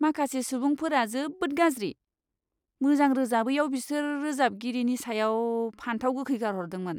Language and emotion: Bodo, disgusted